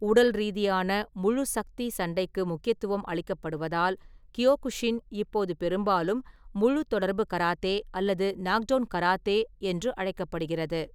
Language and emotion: Tamil, neutral